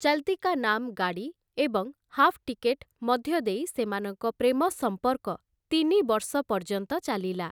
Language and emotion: Odia, neutral